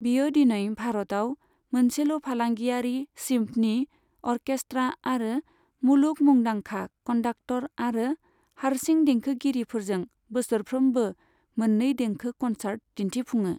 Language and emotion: Bodo, neutral